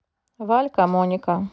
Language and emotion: Russian, neutral